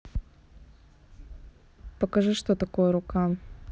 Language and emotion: Russian, neutral